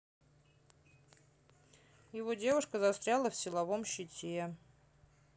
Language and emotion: Russian, neutral